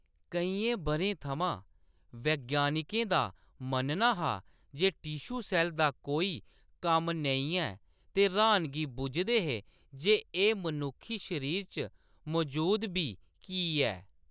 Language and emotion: Dogri, neutral